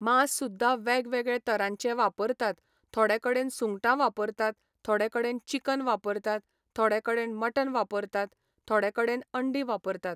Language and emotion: Goan Konkani, neutral